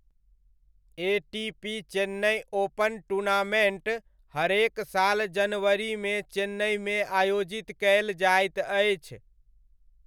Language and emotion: Maithili, neutral